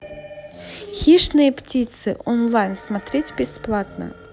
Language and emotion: Russian, neutral